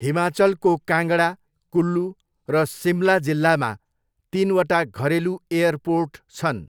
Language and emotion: Nepali, neutral